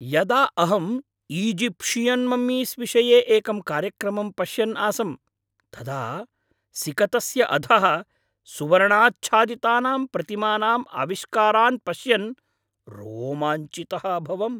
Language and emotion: Sanskrit, happy